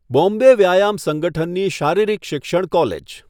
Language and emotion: Gujarati, neutral